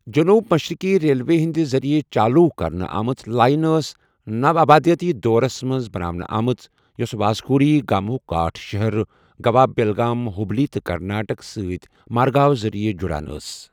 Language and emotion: Kashmiri, neutral